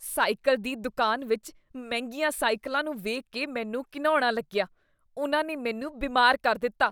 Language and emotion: Punjabi, disgusted